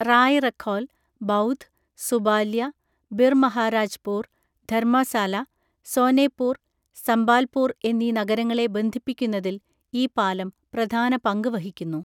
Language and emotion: Malayalam, neutral